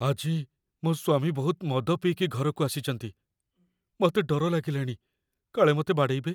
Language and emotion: Odia, fearful